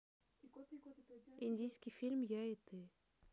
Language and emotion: Russian, neutral